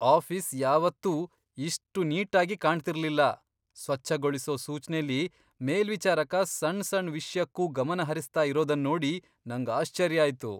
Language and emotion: Kannada, surprised